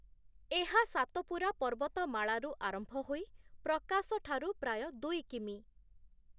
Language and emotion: Odia, neutral